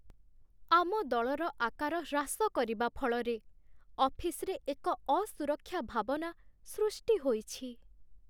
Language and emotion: Odia, sad